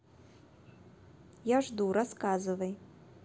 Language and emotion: Russian, neutral